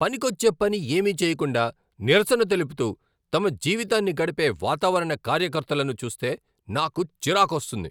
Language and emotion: Telugu, angry